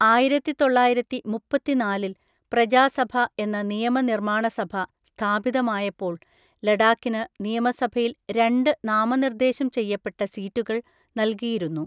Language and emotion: Malayalam, neutral